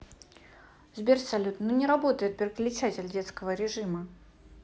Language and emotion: Russian, angry